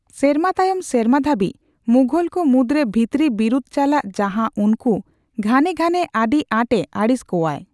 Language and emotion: Santali, neutral